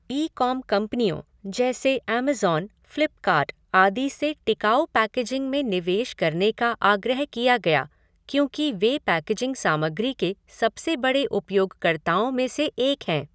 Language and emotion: Hindi, neutral